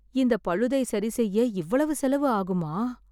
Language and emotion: Tamil, sad